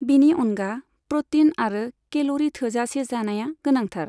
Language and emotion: Bodo, neutral